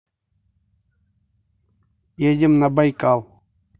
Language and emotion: Russian, neutral